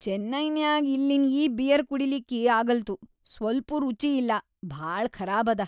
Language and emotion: Kannada, disgusted